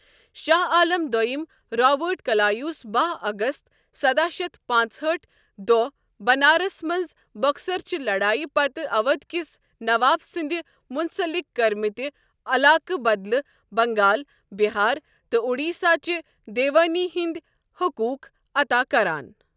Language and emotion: Kashmiri, neutral